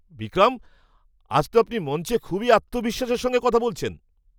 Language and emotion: Bengali, surprised